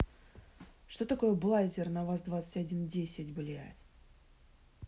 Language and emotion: Russian, angry